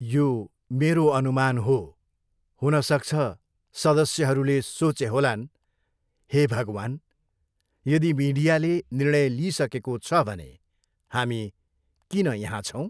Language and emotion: Nepali, neutral